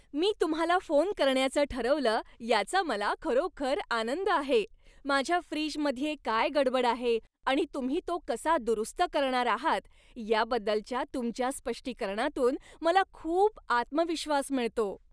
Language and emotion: Marathi, happy